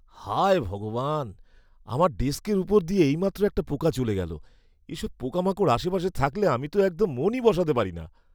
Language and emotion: Bengali, disgusted